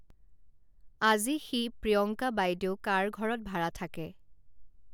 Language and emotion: Assamese, neutral